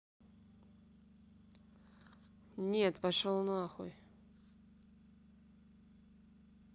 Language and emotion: Russian, neutral